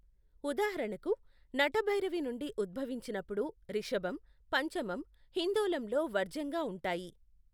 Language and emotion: Telugu, neutral